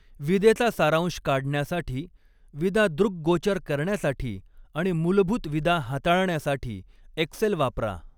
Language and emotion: Marathi, neutral